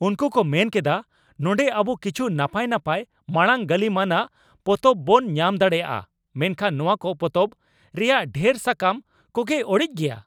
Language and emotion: Santali, angry